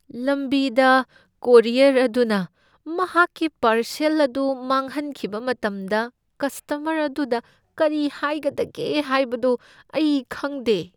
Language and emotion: Manipuri, fearful